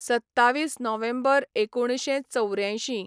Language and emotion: Goan Konkani, neutral